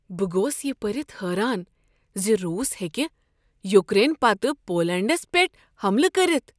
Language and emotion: Kashmiri, surprised